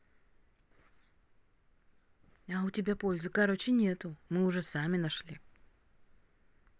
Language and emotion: Russian, neutral